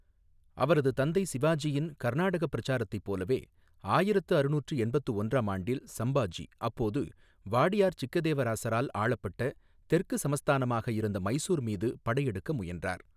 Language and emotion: Tamil, neutral